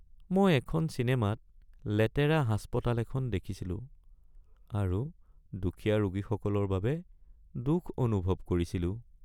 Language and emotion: Assamese, sad